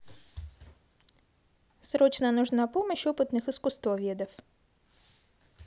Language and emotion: Russian, positive